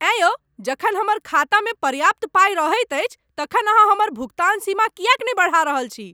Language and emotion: Maithili, angry